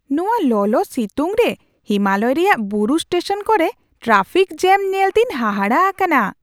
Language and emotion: Santali, surprised